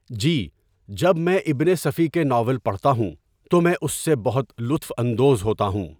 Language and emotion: Urdu, neutral